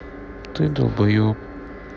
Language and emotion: Russian, sad